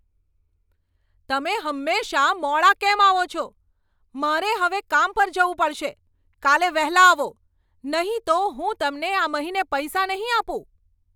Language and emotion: Gujarati, angry